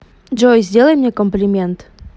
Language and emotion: Russian, neutral